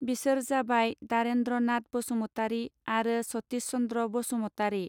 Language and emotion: Bodo, neutral